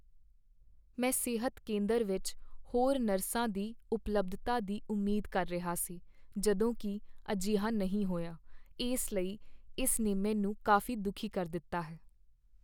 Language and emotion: Punjabi, sad